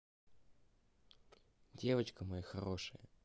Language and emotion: Russian, neutral